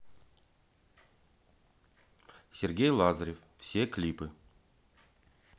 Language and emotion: Russian, neutral